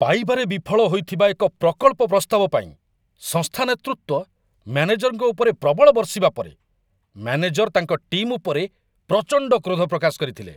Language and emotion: Odia, angry